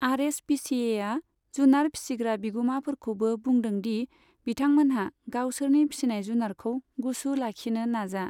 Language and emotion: Bodo, neutral